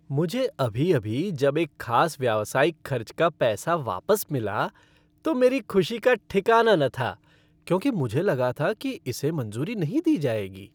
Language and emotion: Hindi, happy